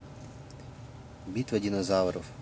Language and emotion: Russian, neutral